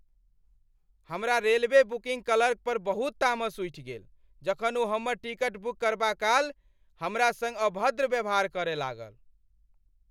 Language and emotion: Maithili, angry